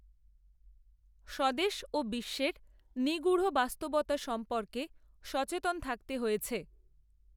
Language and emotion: Bengali, neutral